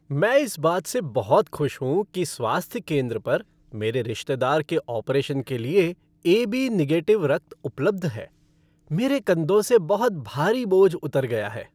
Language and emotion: Hindi, happy